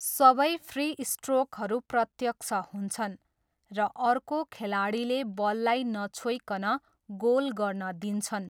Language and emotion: Nepali, neutral